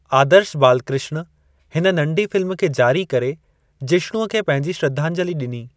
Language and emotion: Sindhi, neutral